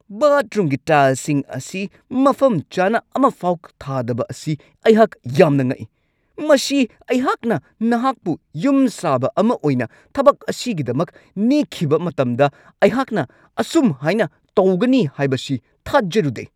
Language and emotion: Manipuri, angry